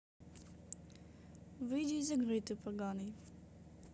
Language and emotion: Russian, neutral